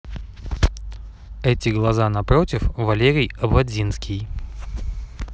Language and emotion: Russian, neutral